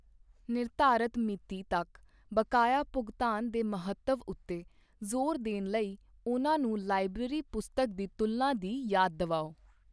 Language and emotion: Punjabi, neutral